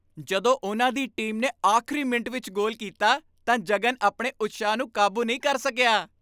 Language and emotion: Punjabi, happy